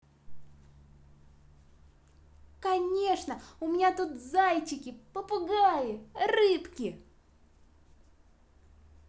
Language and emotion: Russian, positive